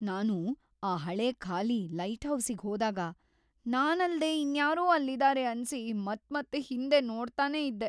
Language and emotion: Kannada, fearful